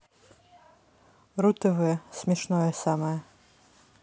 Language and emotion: Russian, neutral